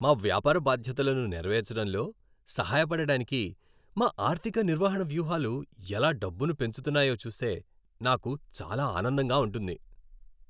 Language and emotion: Telugu, happy